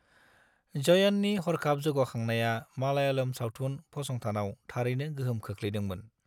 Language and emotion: Bodo, neutral